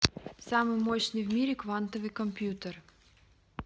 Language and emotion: Russian, neutral